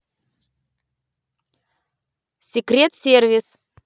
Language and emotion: Russian, neutral